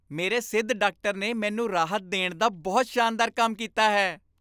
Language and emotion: Punjabi, happy